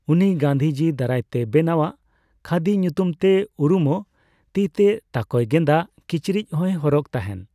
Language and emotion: Santali, neutral